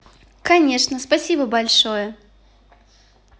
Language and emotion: Russian, positive